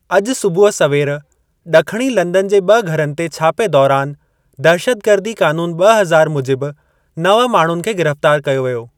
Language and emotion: Sindhi, neutral